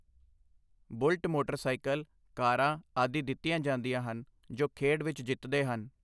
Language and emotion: Punjabi, neutral